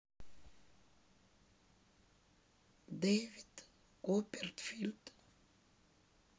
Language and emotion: Russian, sad